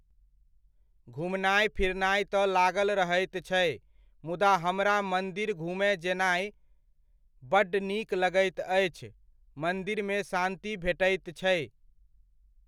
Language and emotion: Maithili, neutral